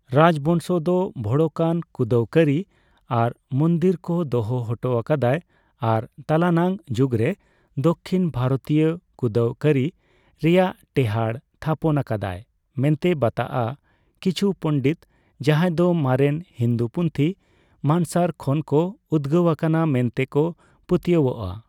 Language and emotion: Santali, neutral